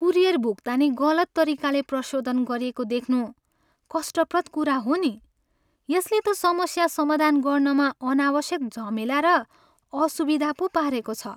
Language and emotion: Nepali, sad